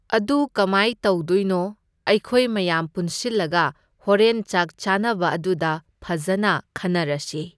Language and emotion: Manipuri, neutral